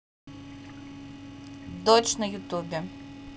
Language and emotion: Russian, neutral